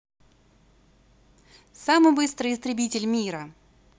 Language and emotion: Russian, positive